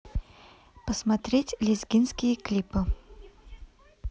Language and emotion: Russian, neutral